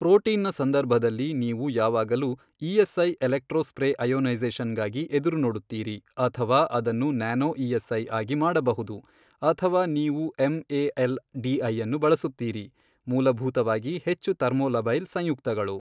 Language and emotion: Kannada, neutral